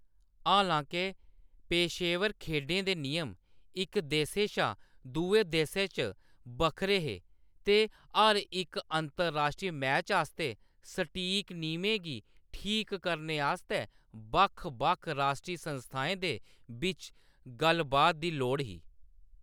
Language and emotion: Dogri, neutral